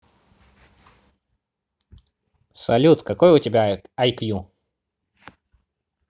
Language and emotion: Russian, positive